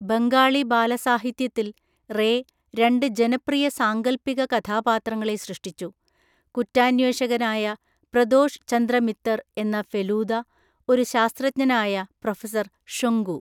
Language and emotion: Malayalam, neutral